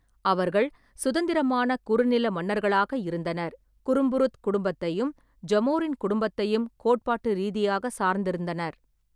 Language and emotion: Tamil, neutral